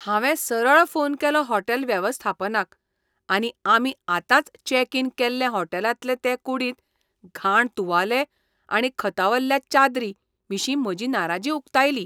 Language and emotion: Goan Konkani, disgusted